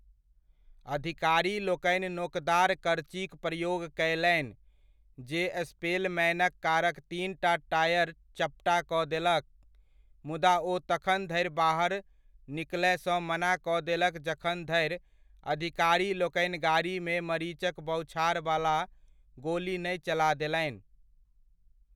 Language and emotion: Maithili, neutral